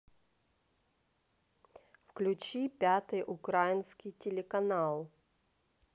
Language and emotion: Russian, neutral